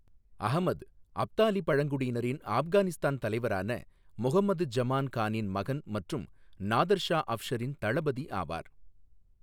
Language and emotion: Tamil, neutral